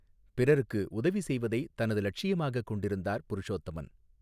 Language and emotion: Tamil, neutral